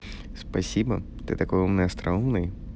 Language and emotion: Russian, positive